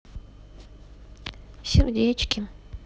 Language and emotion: Russian, sad